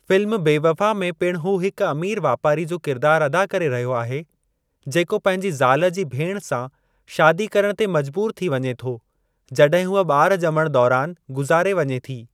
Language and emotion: Sindhi, neutral